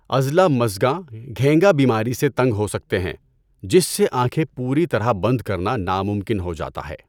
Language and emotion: Urdu, neutral